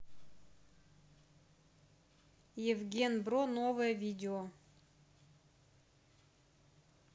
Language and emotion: Russian, neutral